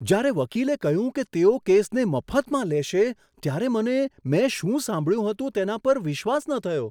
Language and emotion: Gujarati, surprised